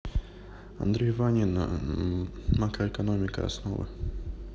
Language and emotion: Russian, neutral